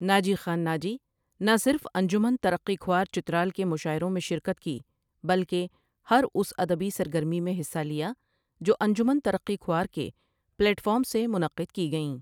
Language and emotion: Urdu, neutral